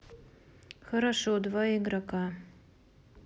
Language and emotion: Russian, neutral